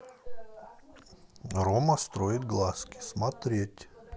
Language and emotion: Russian, neutral